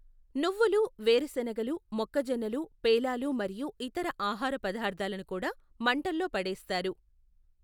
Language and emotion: Telugu, neutral